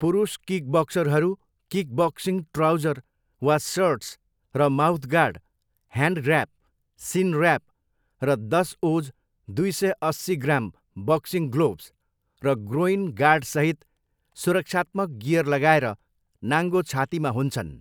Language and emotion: Nepali, neutral